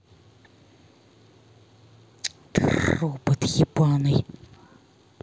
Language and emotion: Russian, angry